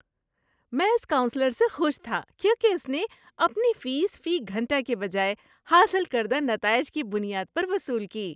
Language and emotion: Urdu, happy